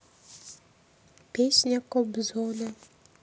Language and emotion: Russian, neutral